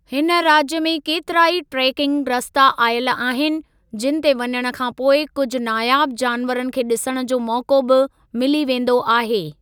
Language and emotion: Sindhi, neutral